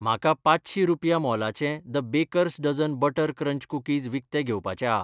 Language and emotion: Goan Konkani, neutral